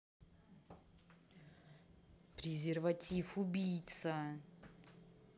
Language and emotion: Russian, angry